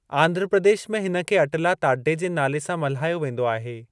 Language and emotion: Sindhi, neutral